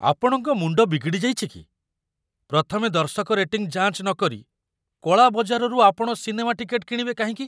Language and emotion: Odia, surprised